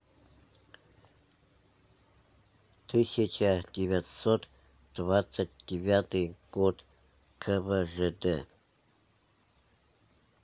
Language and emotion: Russian, neutral